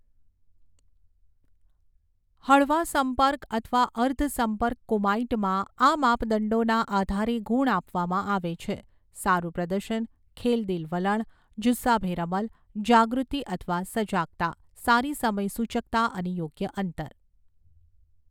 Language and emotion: Gujarati, neutral